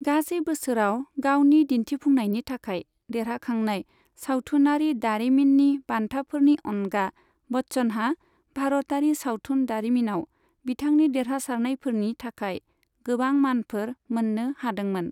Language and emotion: Bodo, neutral